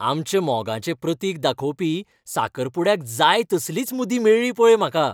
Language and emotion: Goan Konkani, happy